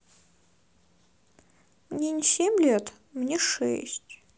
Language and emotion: Russian, sad